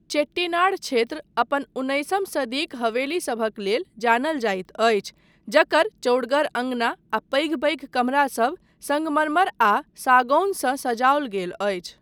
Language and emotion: Maithili, neutral